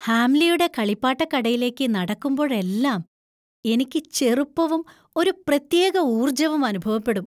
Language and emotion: Malayalam, happy